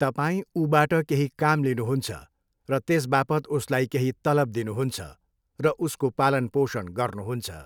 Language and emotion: Nepali, neutral